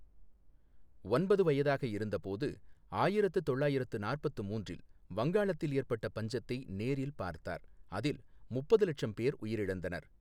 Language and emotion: Tamil, neutral